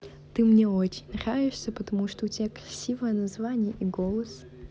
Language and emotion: Russian, positive